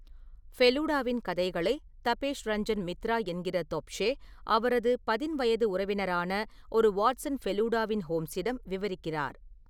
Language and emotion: Tamil, neutral